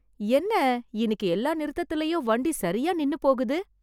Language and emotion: Tamil, surprised